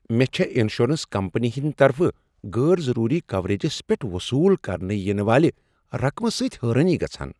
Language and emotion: Kashmiri, surprised